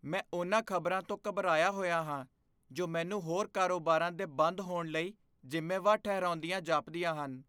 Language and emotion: Punjabi, fearful